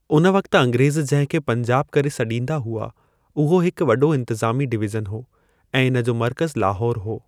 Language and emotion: Sindhi, neutral